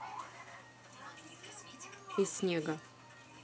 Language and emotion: Russian, neutral